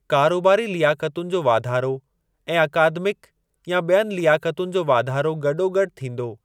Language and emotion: Sindhi, neutral